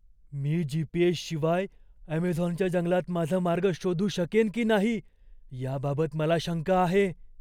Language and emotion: Marathi, fearful